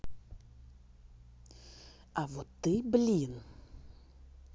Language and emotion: Russian, angry